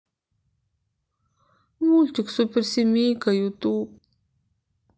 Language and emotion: Russian, sad